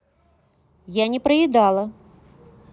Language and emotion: Russian, neutral